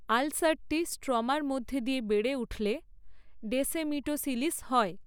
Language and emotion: Bengali, neutral